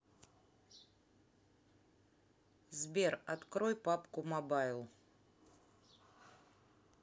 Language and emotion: Russian, neutral